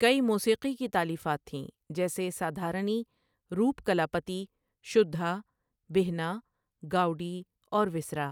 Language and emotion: Urdu, neutral